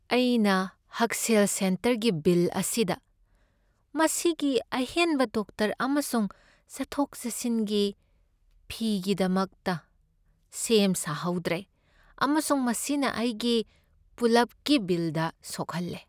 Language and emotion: Manipuri, sad